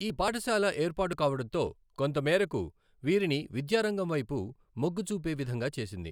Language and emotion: Telugu, neutral